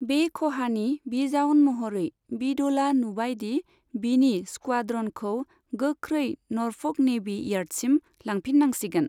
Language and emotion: Bodo, neutral